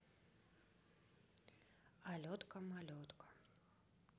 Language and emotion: Russian, neutral